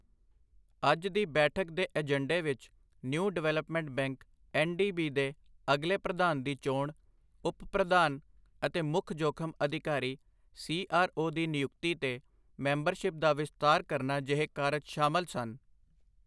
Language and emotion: Punjabi, neutral